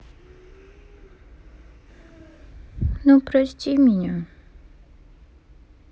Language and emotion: Russian, sad